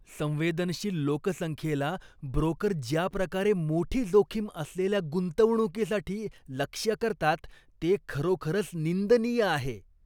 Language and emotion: Marathi, disgusted